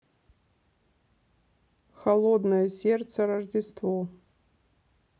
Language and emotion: Russian, neutral